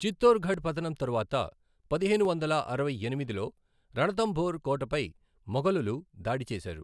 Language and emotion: Telugu, neutral